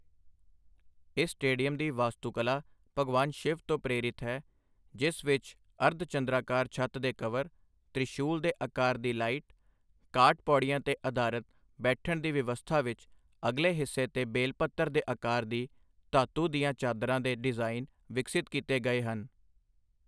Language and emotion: Punjabi, neutral